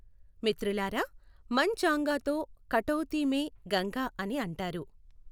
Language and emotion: Telugu, neutral